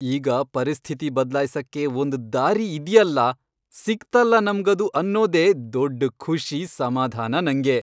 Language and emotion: Kannada, happy